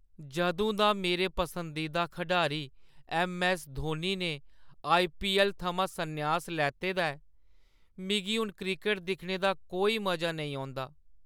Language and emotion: Dogri, sad